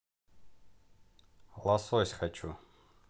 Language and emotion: Russian, neutral